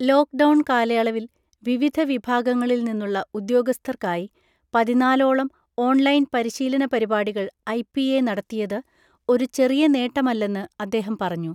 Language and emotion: Malayalam, neutral